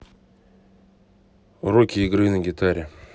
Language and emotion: Russian, neutral